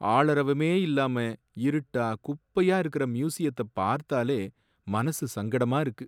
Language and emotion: Tamil, sad